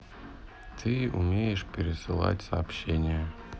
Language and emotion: Russian, neutral